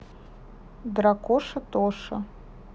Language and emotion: Russian, neutral